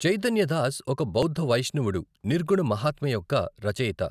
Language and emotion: Telugu, neutral